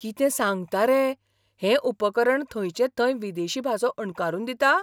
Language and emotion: Goan Konkani, surprised